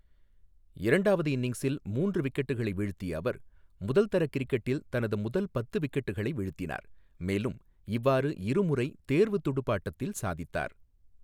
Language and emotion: Tamil, neutral